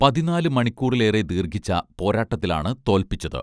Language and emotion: Malayalam, neutral